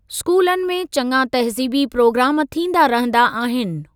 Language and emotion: Sindhi, neutral